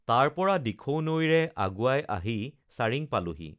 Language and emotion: Assamese, neutral